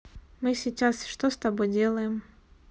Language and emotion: Russian, neutral